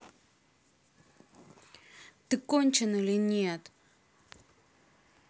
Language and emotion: Russian, angry